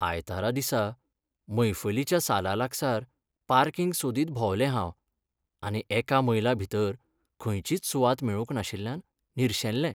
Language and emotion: Goan Konkani, sad